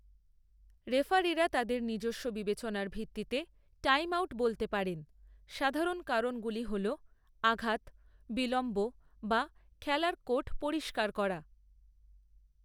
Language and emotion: Bengali, neutral